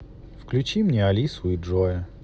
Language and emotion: Russian, neutral